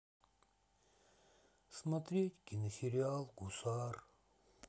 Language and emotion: Russian, sad